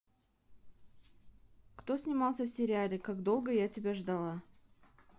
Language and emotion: Russian, neutral